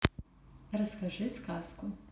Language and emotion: Russian, neutral